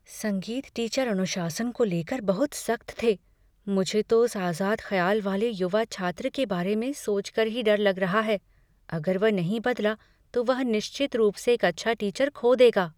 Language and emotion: Hindi, fearful